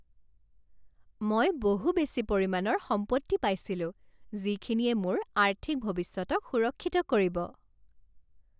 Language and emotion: Assamese, happy